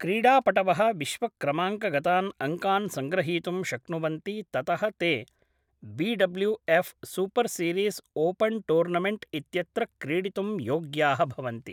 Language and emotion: Sanskrit, neutral